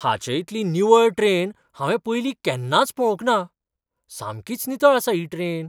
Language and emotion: Goan Konkani, surprised